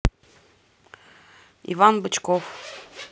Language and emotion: Russian, neutral